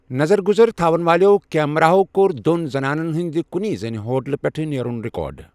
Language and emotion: Kashmiri, neutral